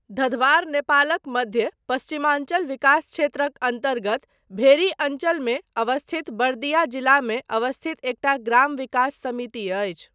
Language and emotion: Maithili, neutral